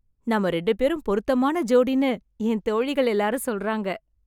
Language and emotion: Tamil, happy